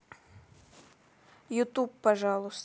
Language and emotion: Russian, neutral